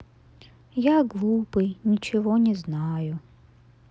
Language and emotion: Russian, neutral